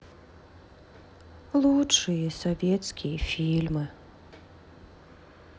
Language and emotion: Russian, sad